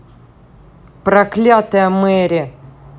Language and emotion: Russian, angry